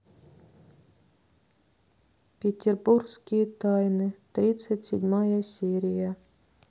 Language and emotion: Russian, sad